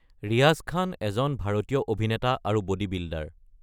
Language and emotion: Assamese, neutral